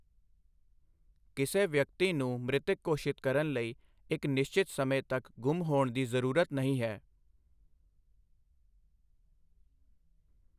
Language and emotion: Punjabi, neutral